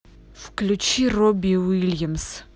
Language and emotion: Russian, angry